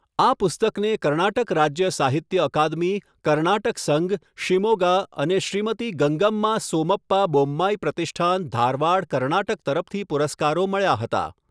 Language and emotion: Gujarati, neutral